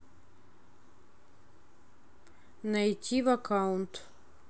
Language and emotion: Russian, neutral